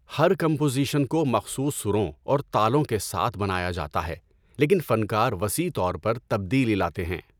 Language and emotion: Urdu, neutral